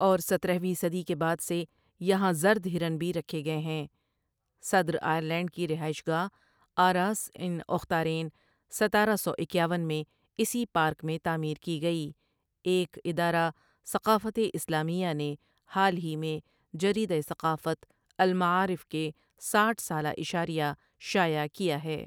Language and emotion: Urdu, neutral